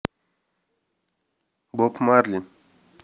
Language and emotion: Russian, neutral